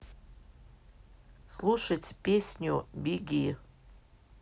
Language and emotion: Russian, neutral